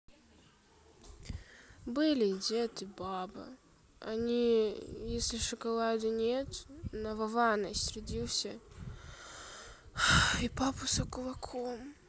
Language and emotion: Russian, sad